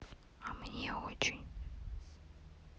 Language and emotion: Russian, sad